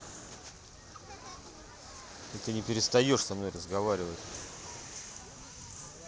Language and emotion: Russian, angry